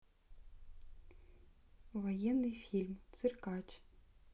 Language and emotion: Russian, neutral